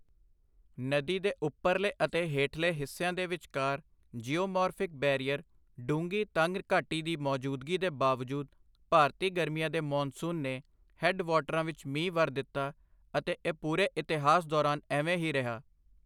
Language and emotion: Punjabi, neutral